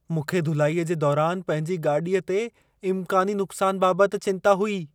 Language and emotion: Sindhi, fearful